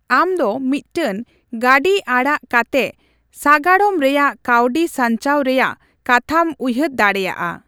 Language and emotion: Santali, neutral